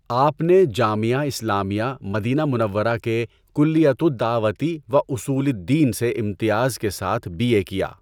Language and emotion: Urdu, neutral